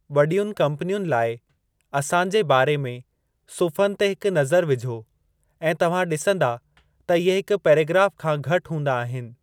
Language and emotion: Sindhi, neutral